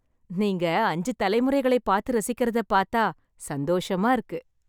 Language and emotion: Tamil, happy